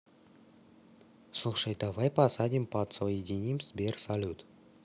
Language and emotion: Russian, neutral